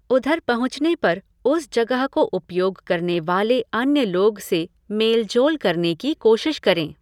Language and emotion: Hindi, neutral